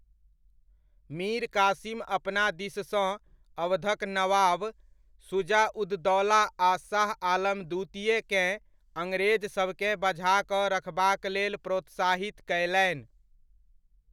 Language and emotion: Maithili, neutral